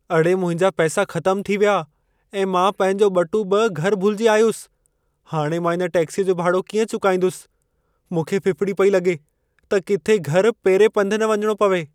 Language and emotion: Sindhi, fearful